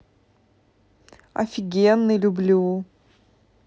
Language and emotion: Russian, positive